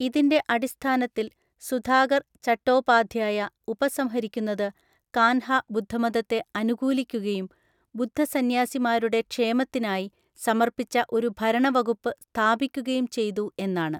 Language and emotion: Malayalam, neutral